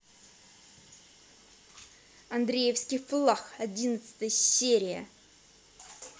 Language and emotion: Russian, angry